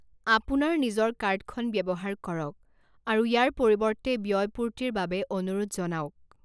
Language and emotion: Assamese, neutral